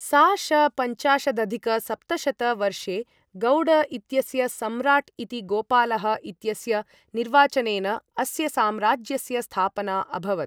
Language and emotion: Sanskrit, neutral